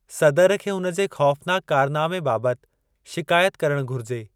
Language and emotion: Sindhi, neutral